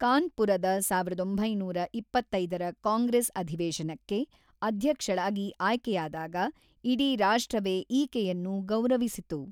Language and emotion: Kannada, neutral